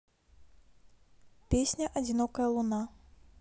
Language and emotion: Russian, neutral